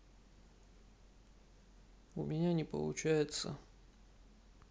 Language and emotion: Russian, sad